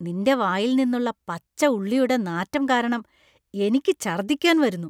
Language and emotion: Malayalam, disgusted